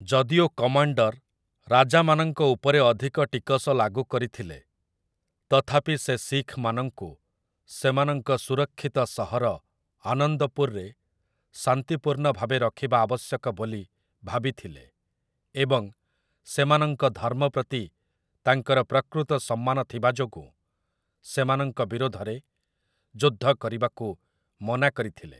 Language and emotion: Odia, neutral